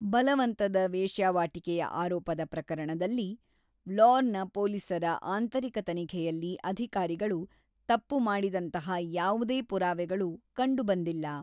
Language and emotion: Kannada, neutral